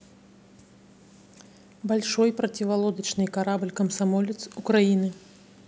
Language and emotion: Russian, neutral